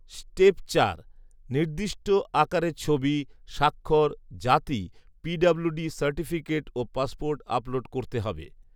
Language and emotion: Bengali, neutral